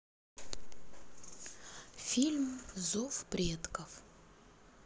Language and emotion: Russian, neutral